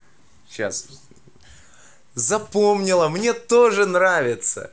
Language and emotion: Russian, positive